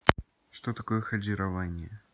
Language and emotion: Russian, neutral